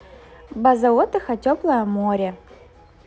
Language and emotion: Russian, positive